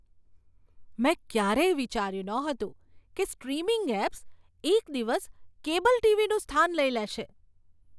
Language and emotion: Gujarati, surprised